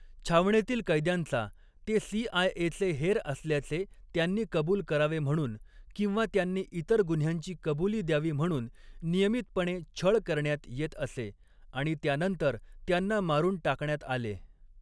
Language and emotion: Marathi, neutral